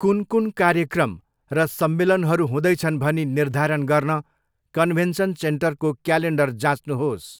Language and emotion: Nepali, neutral